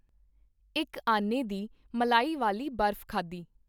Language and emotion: Punjabi, neutral